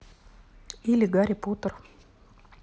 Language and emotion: Russian, neutral